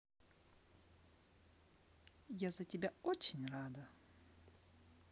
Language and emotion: Russian, positive